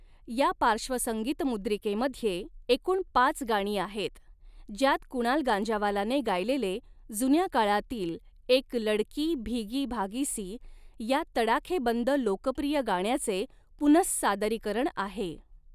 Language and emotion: Marathi, neutral